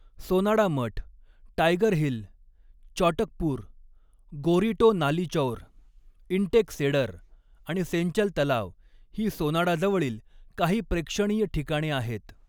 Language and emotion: Marathi, neutral